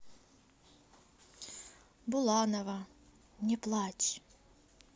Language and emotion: Russian, neutral